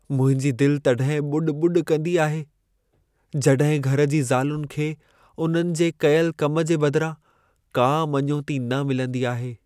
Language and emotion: Sindhi, sad